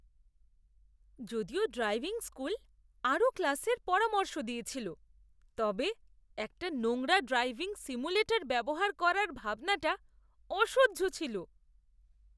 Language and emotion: Bengali, disgusted